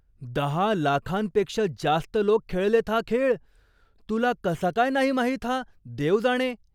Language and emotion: Marathi, surprised